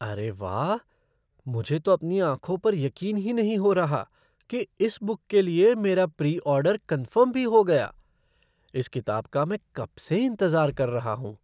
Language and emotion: Hindi, surprised